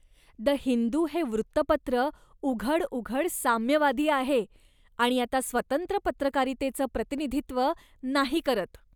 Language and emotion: Marathi, disgusted